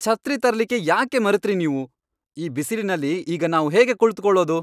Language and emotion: Kannada, angry